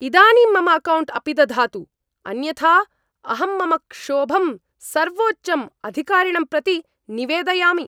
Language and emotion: Sanskrit, angry